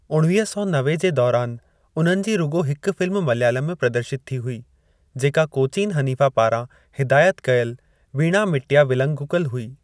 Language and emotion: Sindhi, neutral